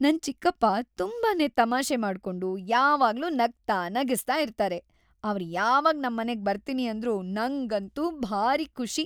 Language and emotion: Kannada, happy